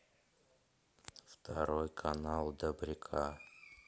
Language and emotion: Russian, neutral